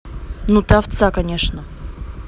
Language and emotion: Russian, angry